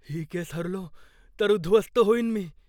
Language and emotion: Marathi, fearful